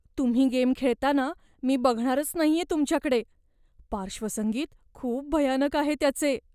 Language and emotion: Marathi, fearful